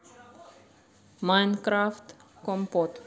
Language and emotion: Russian, neutral